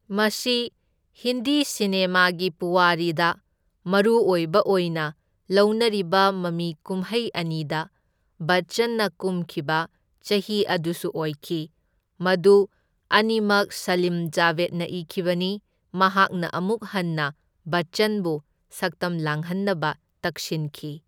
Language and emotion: Manipuri, neutral